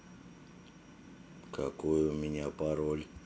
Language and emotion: Russian, neutral